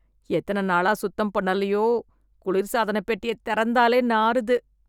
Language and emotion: Tamil, disgusted